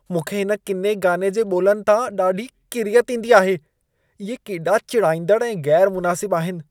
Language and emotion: Sindhi, disgusted